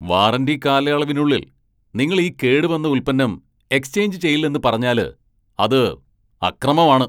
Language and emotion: Malayalam, angry